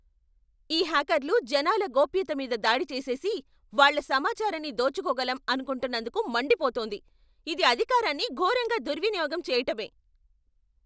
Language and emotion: Telugu, angry